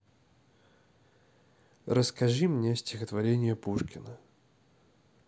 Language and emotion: Russian, neutral